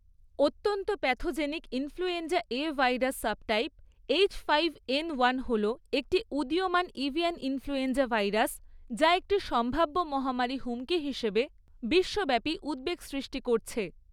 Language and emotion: Bengali, neutral